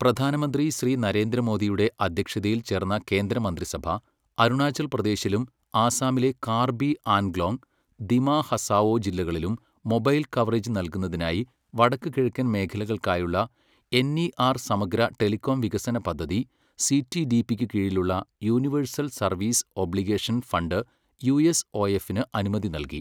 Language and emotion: Malayalam, neutral